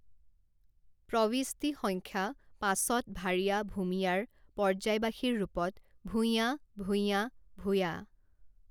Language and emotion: Assamese, neutral